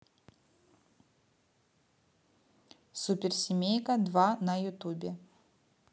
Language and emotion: Russian, neutral